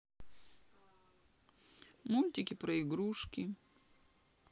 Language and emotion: Russian, sad